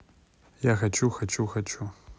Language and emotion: Russian, neutral